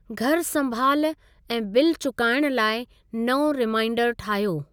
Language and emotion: Sindhi, neutral